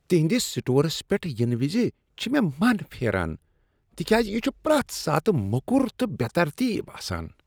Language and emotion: Kashmiri, disgusted